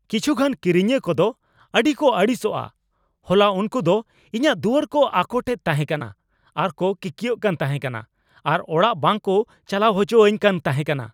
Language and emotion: Santali, angry